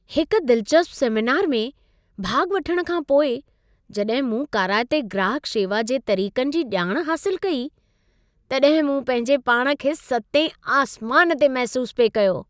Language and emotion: Sindhi, happy